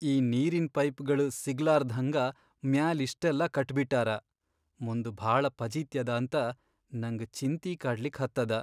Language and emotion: Kannada, sad